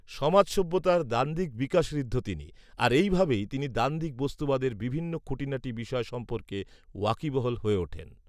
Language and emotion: Bengali, neutral